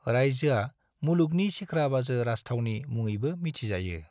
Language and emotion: Bodo, neutral